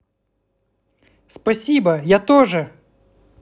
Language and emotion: Russian, positive